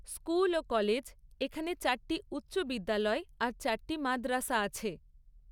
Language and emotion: Bengali, neutral